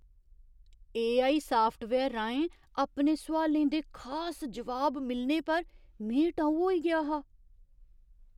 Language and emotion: Dogri, surprised